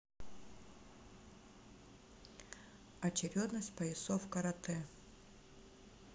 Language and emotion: Russian, neutral